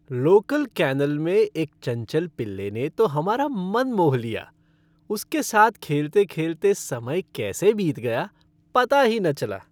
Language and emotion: Hindi, happy